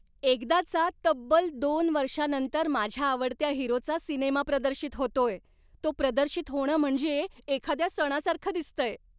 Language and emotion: Marathi, happy